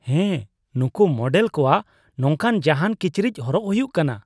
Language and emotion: Santali, disgusted